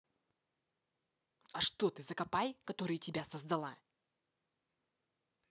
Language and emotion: Russian, angry